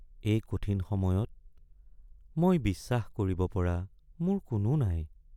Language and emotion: Assamese, sad